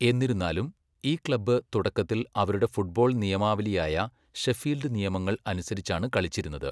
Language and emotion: Malayalam, neutral